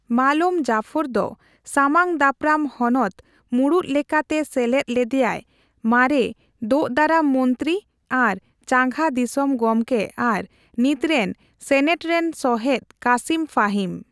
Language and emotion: Santali, neutral